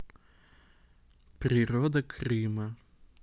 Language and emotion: Russian, neutral